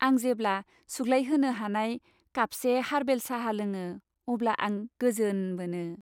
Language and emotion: Bodo, happy